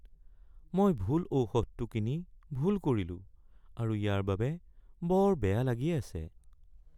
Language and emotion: Assamese, sad